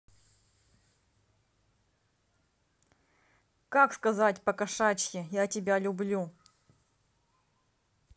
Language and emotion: Russian, neutral